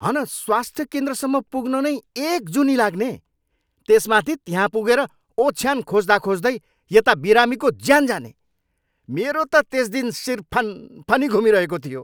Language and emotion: Nepali, angry